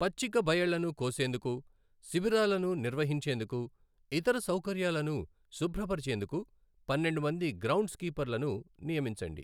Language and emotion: Telugu, neutral